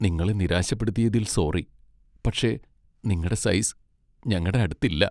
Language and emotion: Malayalam, sad